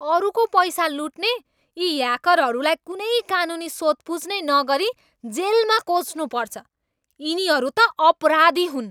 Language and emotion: Nepali, angry